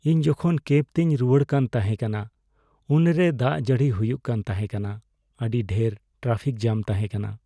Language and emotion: Santali, sad